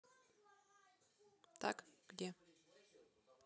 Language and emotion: Russian, neutral